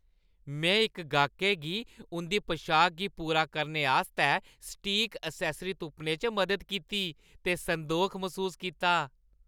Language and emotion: Dogri, happy